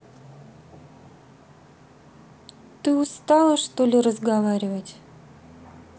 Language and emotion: Russian, neutral